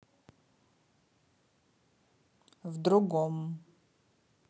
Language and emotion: Russian, neutral